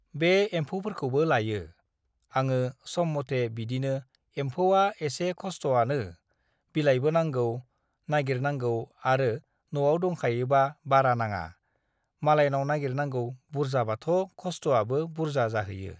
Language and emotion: Bodo, neutral